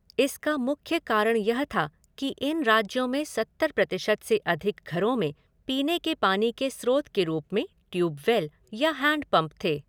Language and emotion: Hindi, neutral